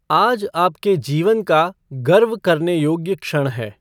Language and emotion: Hindi, neutral